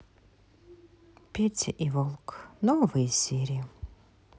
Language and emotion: Russian, sad